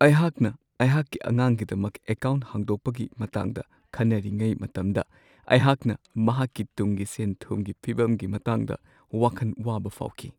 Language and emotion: Manipuri, sad